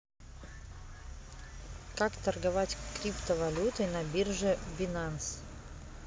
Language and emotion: Russian, neutral